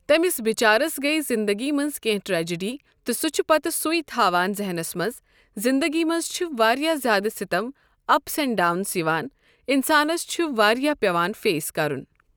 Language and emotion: Kashmiri, neutral